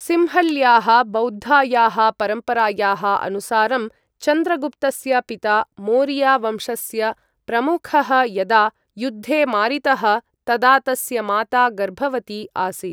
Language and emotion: Sanskrit, neutral